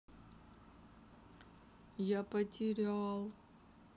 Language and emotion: Russian, sad